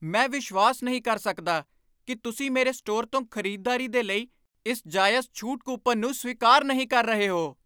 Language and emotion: Punjabi, angry